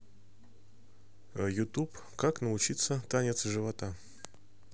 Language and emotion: Russian, neutral